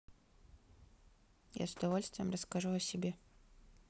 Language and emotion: Russian, neutral